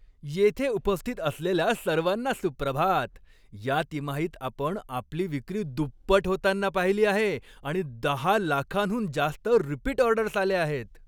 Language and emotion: Marathi, happy